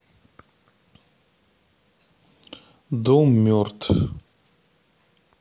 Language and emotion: Russian, neutral